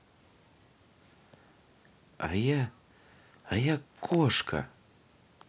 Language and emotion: Russian, neutral